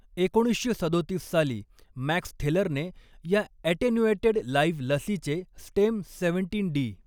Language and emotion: Marathi, neutral